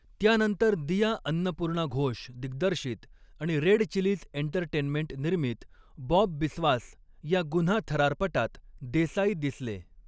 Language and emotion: Marathi, neutral